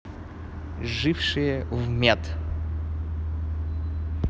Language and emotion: Russian, neutral